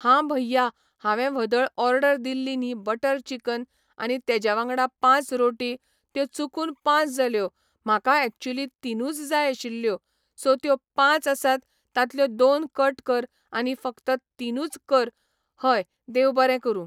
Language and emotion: Goan Konkani, neutral